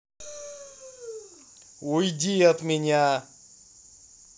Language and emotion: Russian, angry